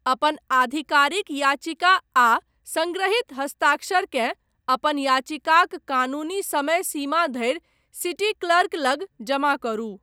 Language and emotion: Maithili, neutral